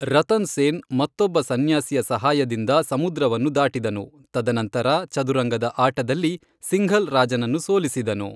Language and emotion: Kannada, neutral